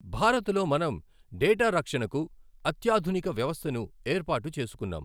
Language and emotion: Telugu, neutral